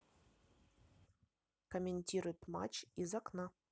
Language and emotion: Russian, neutral